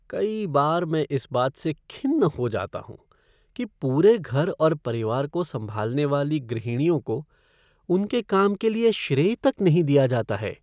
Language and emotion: Hindi, sad